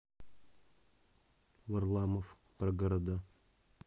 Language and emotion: Russian, neutral